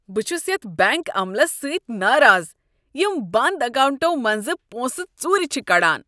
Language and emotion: Kashmiri, disgusted